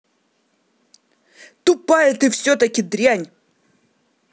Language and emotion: Russian, angry